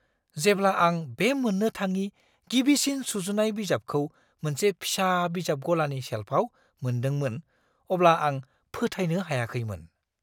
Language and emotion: Bodo, surprised